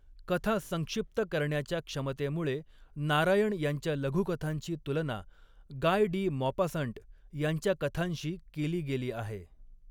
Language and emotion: Marathi, neutral